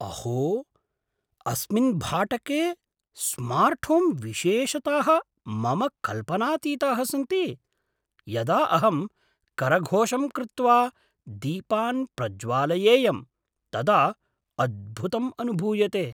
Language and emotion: Sanskrit, surprised